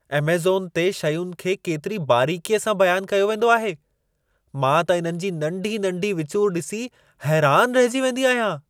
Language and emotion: Sindhi, surprised